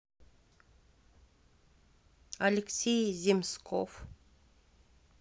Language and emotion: Russian, neutral